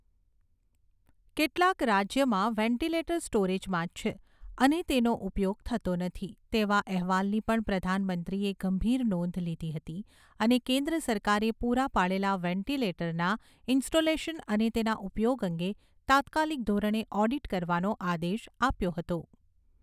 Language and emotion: Gujarati, neutral